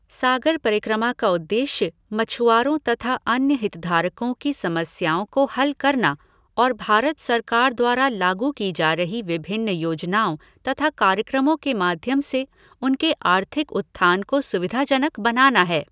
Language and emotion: Hindi, neutral